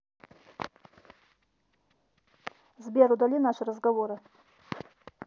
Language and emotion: Russian, neutral